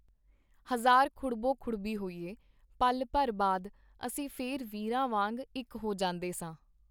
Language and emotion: Punjabi, neutral